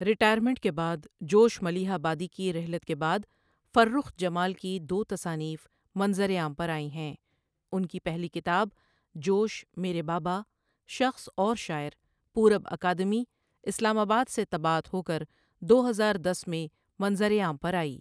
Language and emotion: Urdu, neutral